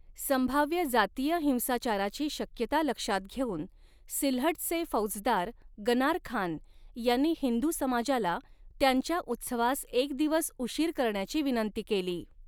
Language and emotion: Marathi, neutral